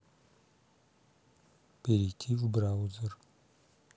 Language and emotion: Russian, neutral